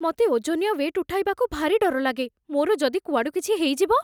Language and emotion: Odia, fearful